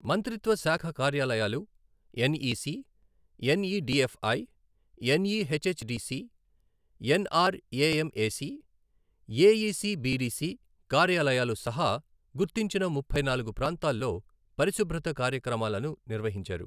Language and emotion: Telugu, neutral